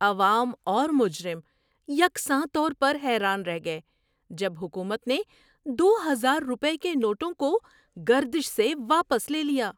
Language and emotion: Urdu, surprised